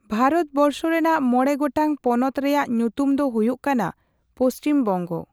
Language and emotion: Santali, neutral